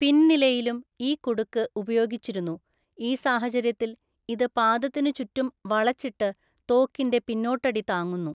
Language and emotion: Malayalam, neutral